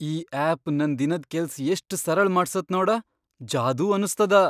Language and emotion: Kannada, surprised